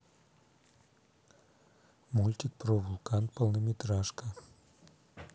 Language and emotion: Russian, neutral